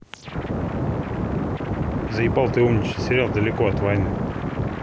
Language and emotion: Russian, angry